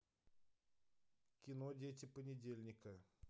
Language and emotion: Russian, neutral